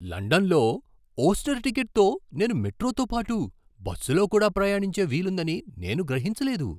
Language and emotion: Telugu, surprised